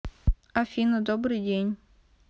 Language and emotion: Russian, neutral